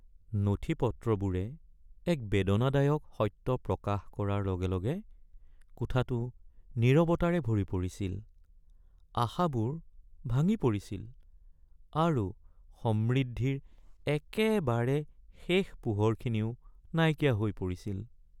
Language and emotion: Assamese, sad